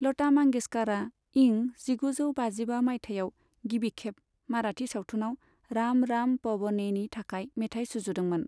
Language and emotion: Bodo, neutral